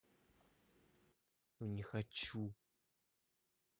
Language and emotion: Russian, angry